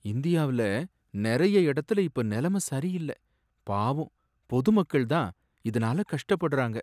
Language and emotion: Tamil, sad